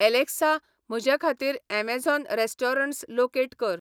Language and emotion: Goan Konkani, neutral